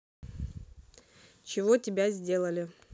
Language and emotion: Russian, neutral